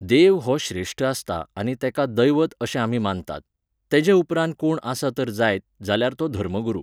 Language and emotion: Goan Konkani, neutral